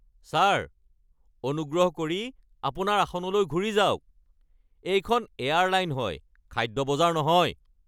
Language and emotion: Assamese, angry